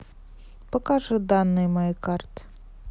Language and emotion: Russian, neutral